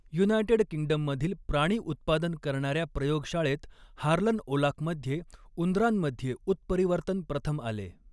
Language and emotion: Marathi, neutral